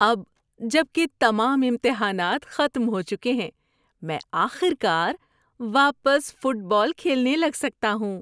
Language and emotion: Urdu, happy